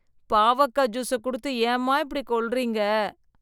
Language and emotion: Tamil, disgusted